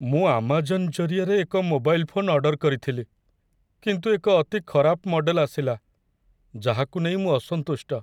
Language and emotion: Odia, sad